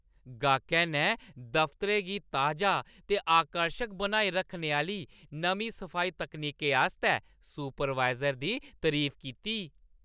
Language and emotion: Dogri, happy